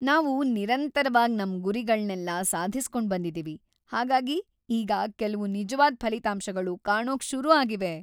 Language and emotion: Kannada, happy